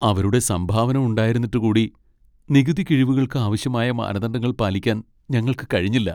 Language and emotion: Malayalam, sad